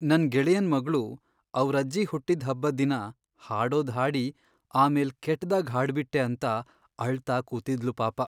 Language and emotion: Kannada, sad